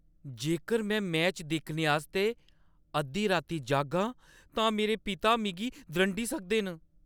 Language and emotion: Dogri, fearful